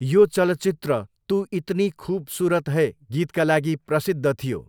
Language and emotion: Nepali, neutral